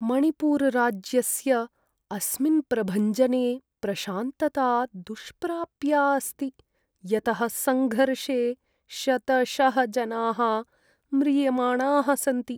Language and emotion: Sanskrit, sad